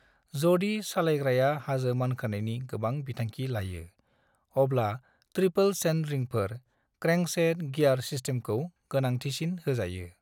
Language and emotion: Bodo, neutral